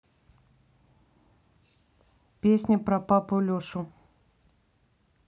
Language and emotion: Russian, neutral